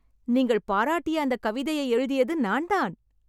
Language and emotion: Tamil, happy